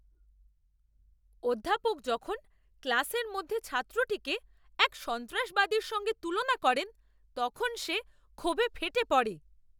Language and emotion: Bengali, angry